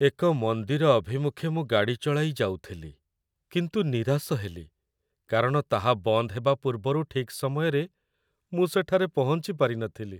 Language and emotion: Odia, sad